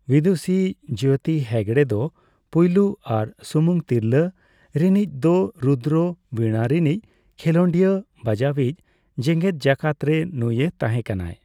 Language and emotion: Santali, neutral